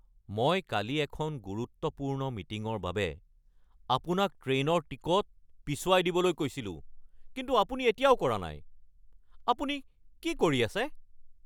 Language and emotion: Assamese, angry